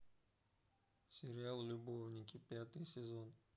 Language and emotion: Russian, neutral